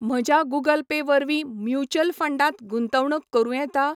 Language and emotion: Goan Konkani, neutral